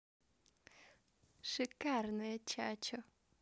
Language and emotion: Russian, positive